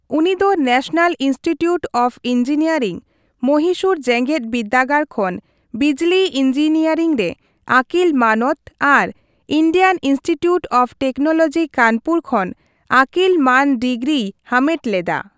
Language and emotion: Santali, neutral